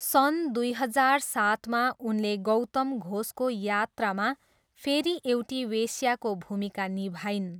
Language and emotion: Nepali, neutral